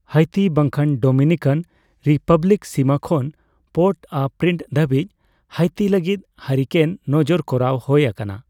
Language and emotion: Santali, neutral